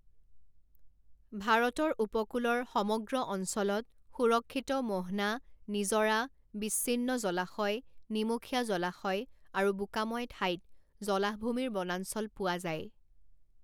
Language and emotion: Assamese, neutral